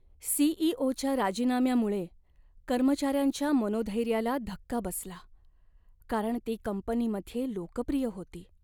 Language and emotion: Marathi, sad